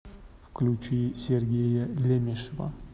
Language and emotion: Russian, neutral